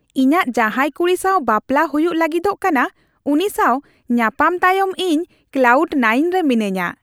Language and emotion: Santali, happy